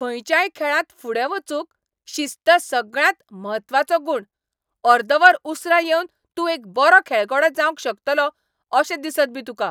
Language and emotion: Goan Konkani, angry